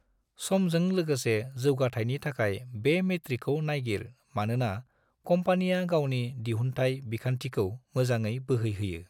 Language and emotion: Bodo, neutral